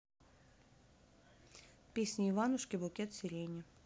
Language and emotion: Russian, neutral